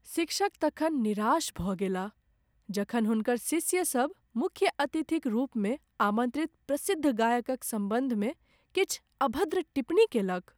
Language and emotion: Maithili, sad